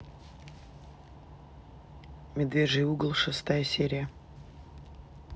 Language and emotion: Russian, neutral